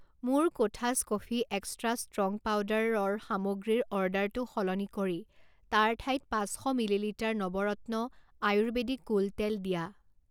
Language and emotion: Assamese, neutral